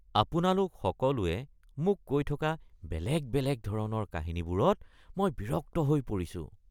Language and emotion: Assamese, disgusted